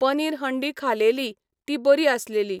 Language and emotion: Goan Konkani, neutral